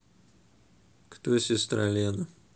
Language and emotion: Russian, neutral